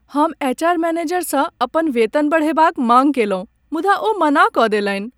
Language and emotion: Maithili, sad